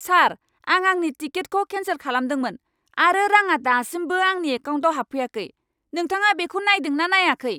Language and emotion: Bodo, angry